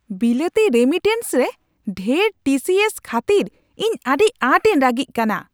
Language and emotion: Santali, angry